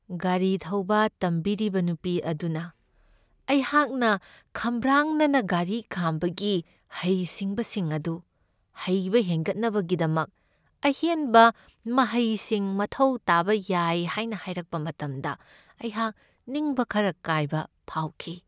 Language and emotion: Manipuri, sad